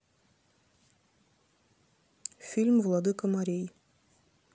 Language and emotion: Russian, neutral